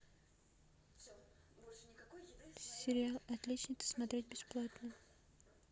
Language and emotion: Russian, neutral